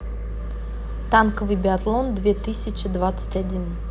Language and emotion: Russian, neutral